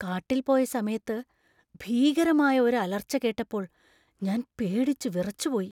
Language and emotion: Malayalam, fearful